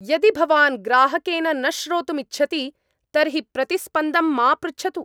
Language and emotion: Sanskrit, angry